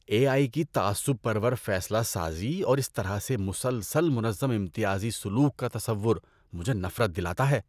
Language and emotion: Urdu, disgusted